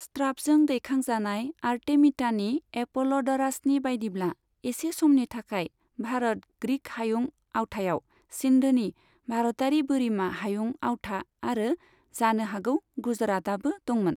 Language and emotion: Bodo, neutral